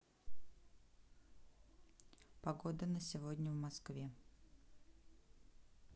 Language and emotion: Russian, neutral